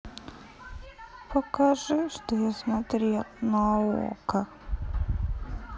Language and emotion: Russian, sad